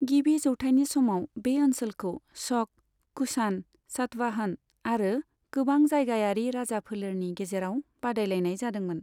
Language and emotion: Bodo, neutral